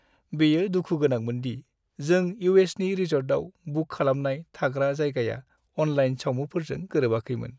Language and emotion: Bodo, sad